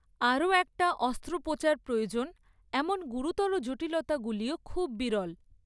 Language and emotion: Bengali, neutral